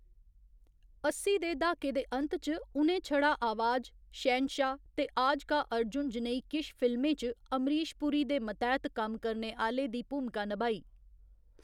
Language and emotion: Dogri, neutral